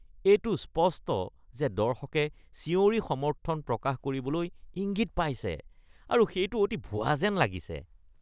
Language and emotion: Assamese, disgusted